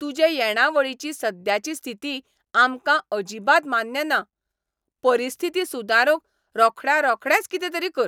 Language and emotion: Goan Konkani, angry